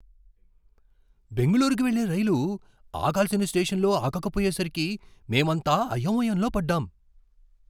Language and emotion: Telugu, surprised